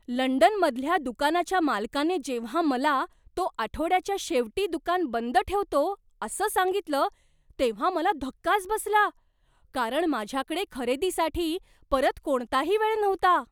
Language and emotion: Marathi, surprised